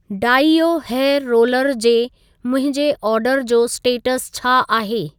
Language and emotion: Sindhi, neutral